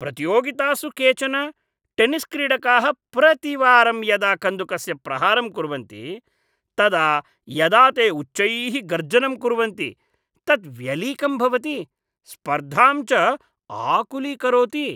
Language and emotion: Sanskrit, disgusted